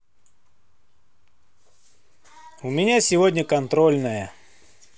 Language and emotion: Russian, positive